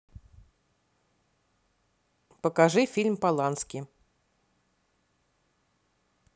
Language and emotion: Russian, neutral